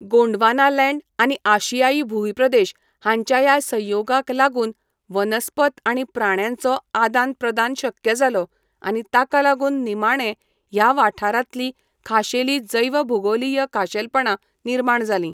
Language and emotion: Goan Konkani, neutral